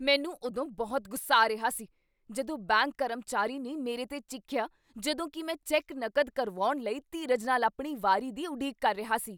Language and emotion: Punjabi, angry